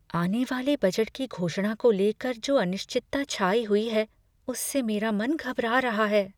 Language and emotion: Hindi, fearful